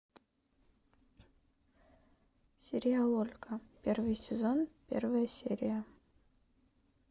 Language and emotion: Russian, neutral